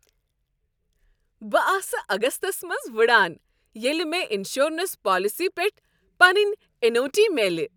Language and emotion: Kashmiri, happy